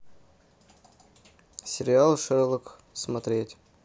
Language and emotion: Russian, neutral